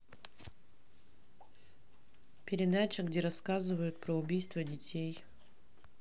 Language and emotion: Russian, neutral